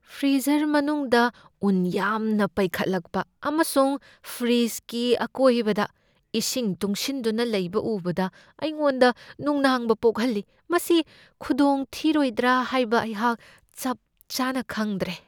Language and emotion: Manipuri, fearful